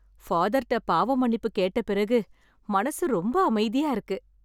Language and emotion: Tamil, happy